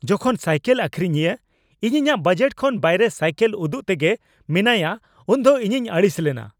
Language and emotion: Santali, angry